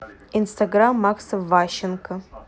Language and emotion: Russian, neutral